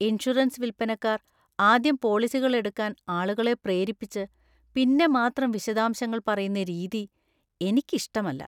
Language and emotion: Malayalam, disgusted